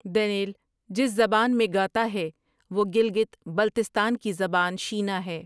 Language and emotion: Urdu, neutral